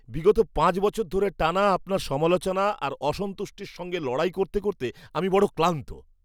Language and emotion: Bengali, disgusted